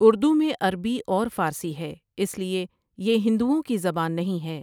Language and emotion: Urdu, neutral